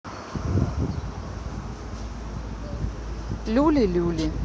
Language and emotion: Russian, neutral